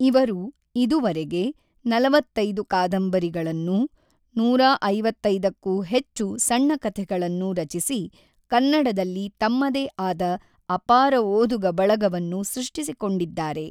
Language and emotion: Kannada, neutral